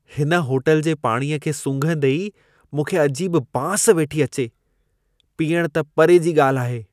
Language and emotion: Sindhi, disgusted